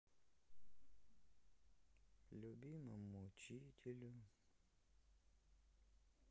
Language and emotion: Russian, sad